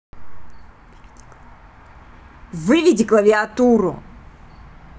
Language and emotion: Russian, angry